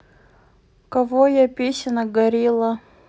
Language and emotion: Russian, neutral